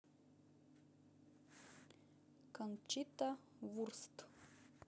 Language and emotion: Russian, neutral